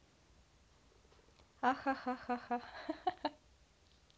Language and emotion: Russian, positive